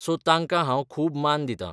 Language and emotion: Goan Konkani, neutral